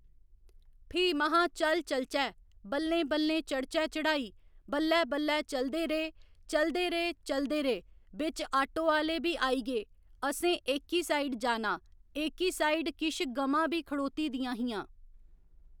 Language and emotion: Dogri, neutral